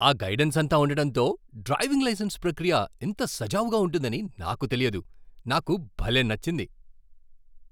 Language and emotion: Telugu, surprised